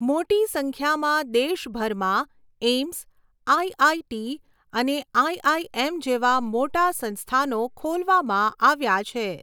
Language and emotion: Gujarati, neutral